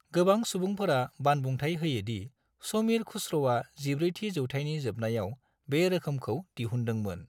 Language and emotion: Bodo, neutral